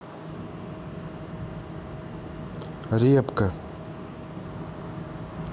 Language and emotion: Russian, neutral